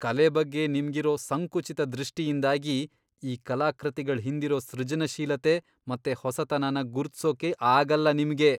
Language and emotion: Kannada, disgusted